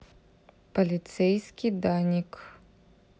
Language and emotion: Russian, neutral